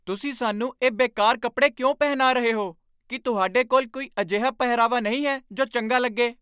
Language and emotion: Punjabi, angry